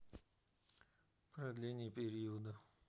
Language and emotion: Russian, neutral